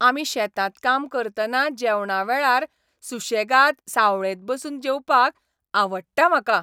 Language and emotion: Goan Konkani, happy